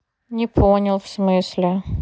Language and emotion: Russian, neutral